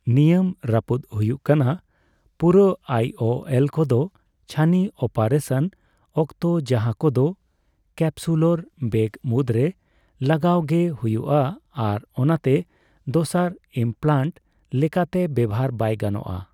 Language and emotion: Santali, neutral